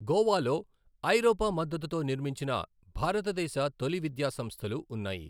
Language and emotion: Telugu, neutral